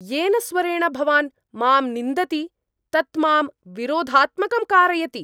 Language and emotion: Sanskrit, angry